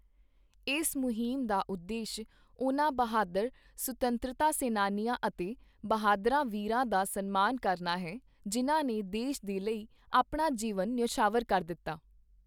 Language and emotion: Punjabi, neutral